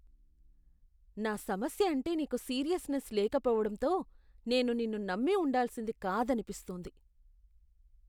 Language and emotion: Telugu, disgusted